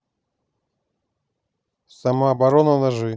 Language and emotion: Russian, neutral